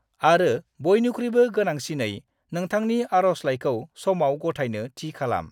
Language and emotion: Bodo, neutral